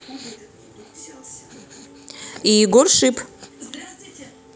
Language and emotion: Russian, neutral